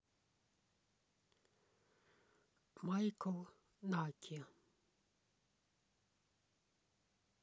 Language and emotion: Russian, neutral